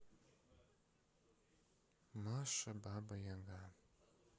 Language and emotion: Russian, sad